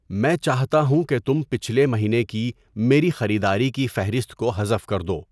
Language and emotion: Urdu, neutral